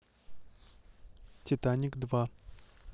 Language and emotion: Russian, neutral